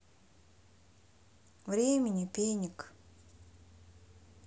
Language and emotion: Russian, neutral